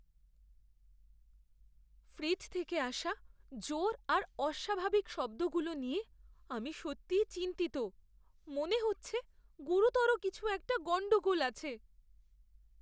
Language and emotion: Bengali, fearful